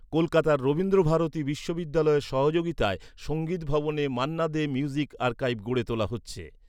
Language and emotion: Bengali, neutral